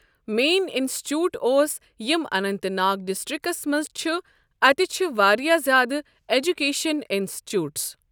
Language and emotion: Kashmiri, neutral